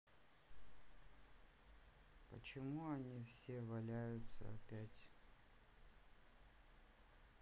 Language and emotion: Russian, sad